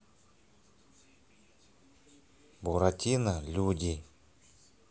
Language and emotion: Russian, neutral